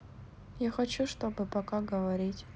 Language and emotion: Russian, sad